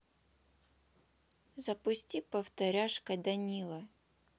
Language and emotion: Russian, neutral